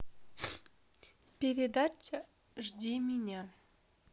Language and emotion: Russian, neutral